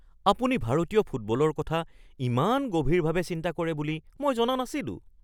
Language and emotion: Assamese, surprised